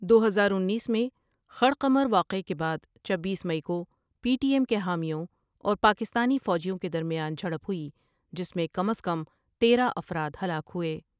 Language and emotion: Urdu, neutral